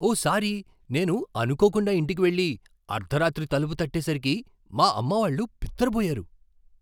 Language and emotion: Telugu, surprised